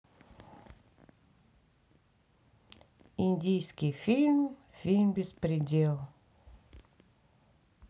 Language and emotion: Russian, neutral